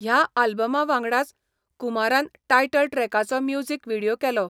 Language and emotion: Goan Konkani, neutral